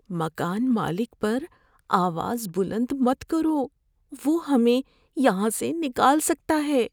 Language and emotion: Urdu, fearful